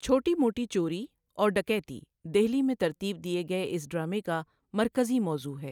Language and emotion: Urdu, neutral